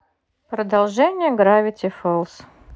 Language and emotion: Russian, neutral